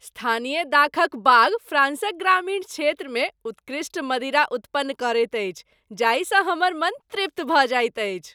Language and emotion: Maithili, happy